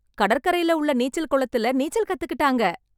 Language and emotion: Tamil, happy